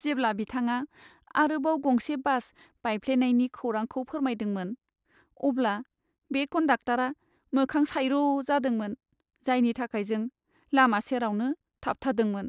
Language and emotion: Bodo, sad